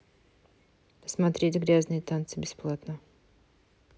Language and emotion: Russian, neutral